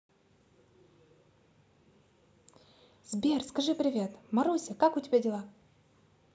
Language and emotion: Russian, positive